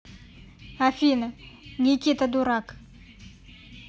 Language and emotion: Russian, neutral